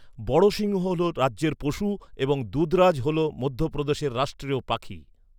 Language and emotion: Bengali, neutral